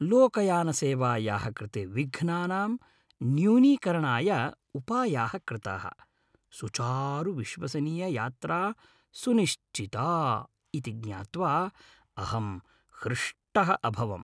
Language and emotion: Sanskrit, happy